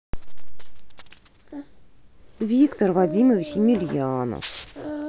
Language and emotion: Russian, neutral